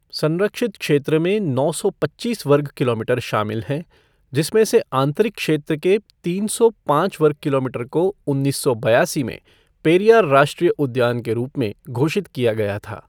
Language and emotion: Hindi, neutral